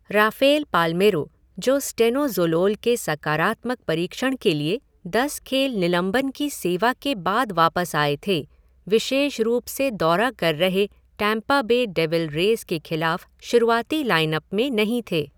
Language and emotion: Hindi, neutral